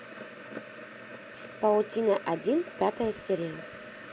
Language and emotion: Russian, positive